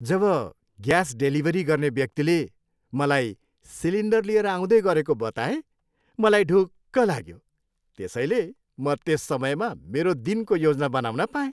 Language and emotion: Nepali, happy